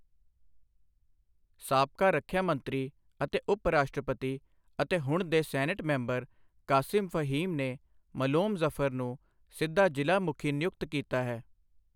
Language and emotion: Punjabi, neutral